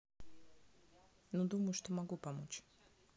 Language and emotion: Russian, neutral